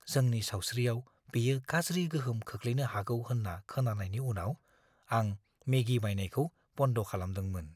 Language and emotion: Bodo, fearful